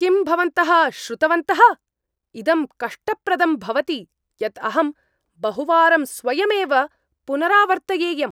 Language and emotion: Sanskrit, angry